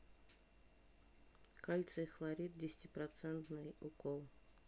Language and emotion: Russian, neutral